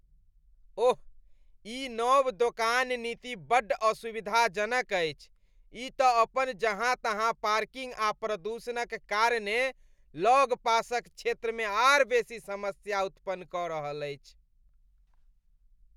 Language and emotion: Maithili, disgusted